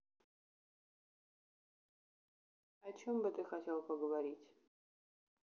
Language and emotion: Russian, neutral